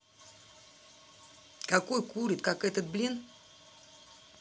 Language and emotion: Russian, angry